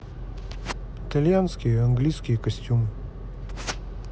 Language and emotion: Russian, neutral